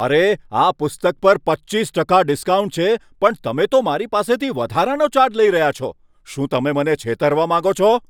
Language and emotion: Gujarati, angry